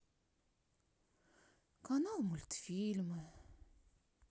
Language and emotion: Russian, sad